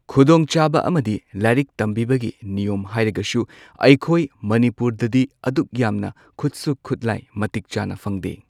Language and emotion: Manipuri, neutral